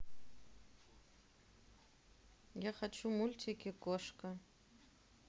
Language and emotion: Russian, neutral